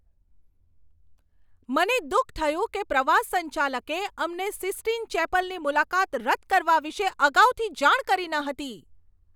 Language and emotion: Gujarati, angry